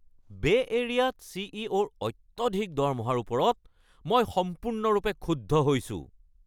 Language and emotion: Assamese, angry